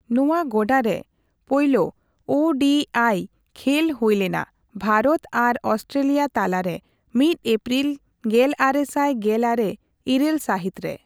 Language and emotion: Santali, neutral